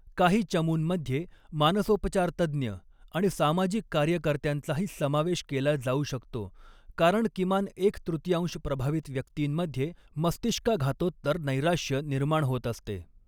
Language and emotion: Marathi, neutral